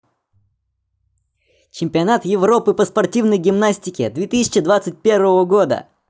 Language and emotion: Russian, positive